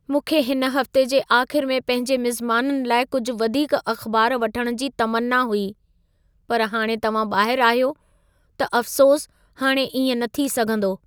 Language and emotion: Sindhi, sad